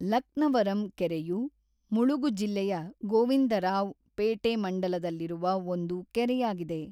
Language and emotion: Kannada, neutral